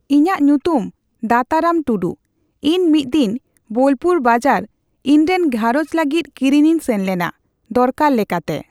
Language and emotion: Santali, neutral